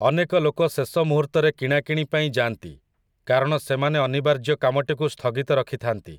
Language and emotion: Odia, neutral